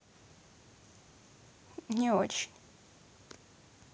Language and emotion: Russian, sad